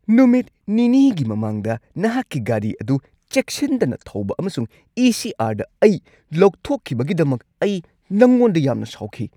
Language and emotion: Manipuri, angry